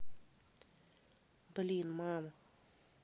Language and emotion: Russian, neutral